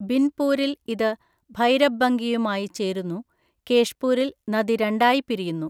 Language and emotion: Malayalam, neutral